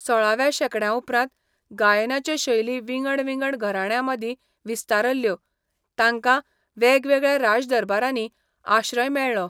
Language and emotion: Goan Konkani, neutral